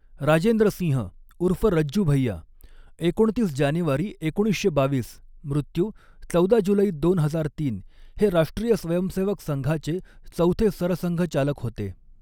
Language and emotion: Marathi, neutral